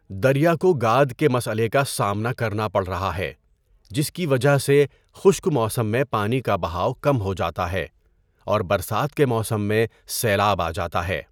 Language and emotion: Urdu, neutral